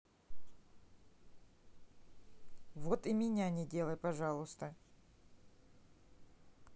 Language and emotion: Russian, neutral